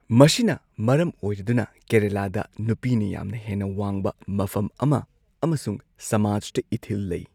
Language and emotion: Manipuri, neutral